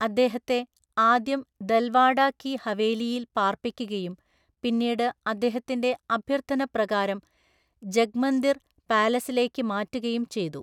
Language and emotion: Malayalam, neutral